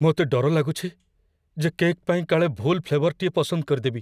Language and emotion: Odia, fearful